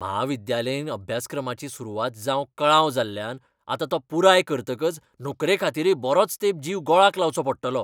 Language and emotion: Goan Konkani, angry